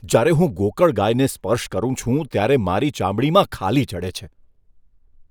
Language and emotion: Gujarati, disgusted